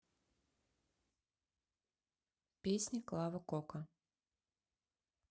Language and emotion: Russian, neutral